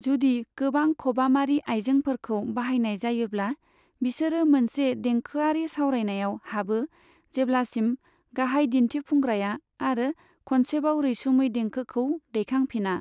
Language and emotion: Bodo, neutral